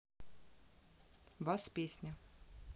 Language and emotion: Russian, neutral